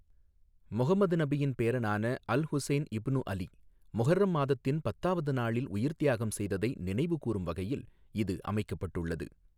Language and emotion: Tamil, neutral